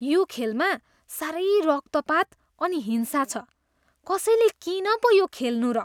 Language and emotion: Nepali, disgusted